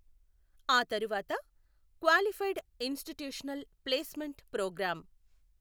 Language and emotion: Telugu, neutral